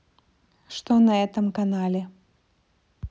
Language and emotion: Russian, neutral